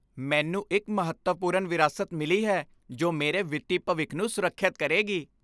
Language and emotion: Punjabi, happy